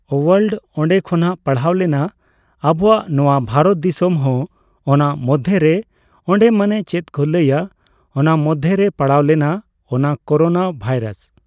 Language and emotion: Santali, neutral